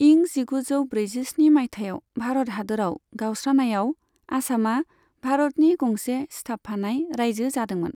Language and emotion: Bodo, neutral